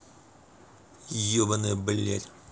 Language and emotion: Russian, angry